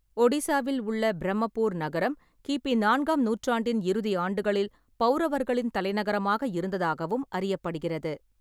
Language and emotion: Tamil, neutral